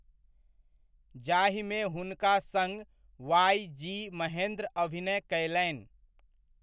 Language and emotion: Maithili, neutral